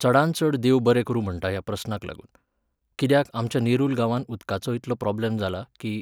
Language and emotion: Goan Konkani, neutral